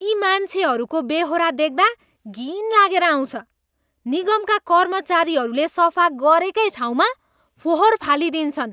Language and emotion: Nepali, disgusted